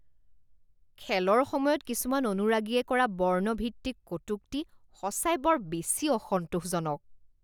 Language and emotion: Assamese, disgusted